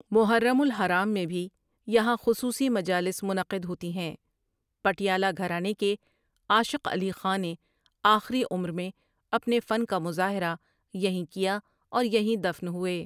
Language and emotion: Urdu, neutral